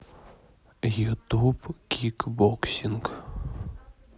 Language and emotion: Russian, neutral